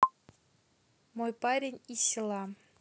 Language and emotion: Russian, neutral